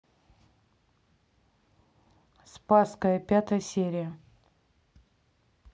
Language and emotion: Russian, neutral